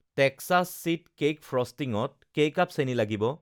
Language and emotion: Assamese, neutral